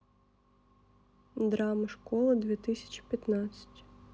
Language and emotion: Russian, sad